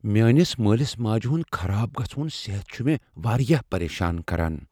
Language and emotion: Kashmiri, fearful